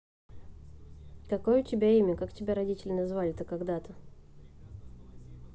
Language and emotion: Russian, neutral